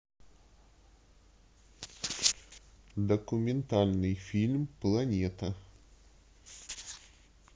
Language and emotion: Russian, neutral